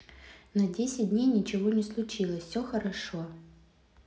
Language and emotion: Russian, neutral